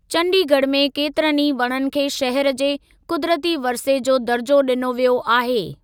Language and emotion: Sindhi, neutral